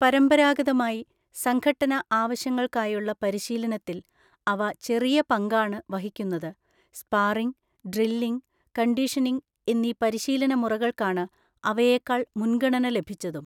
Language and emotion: Malayalam, neutral